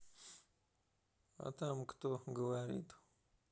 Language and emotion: Russian, neutral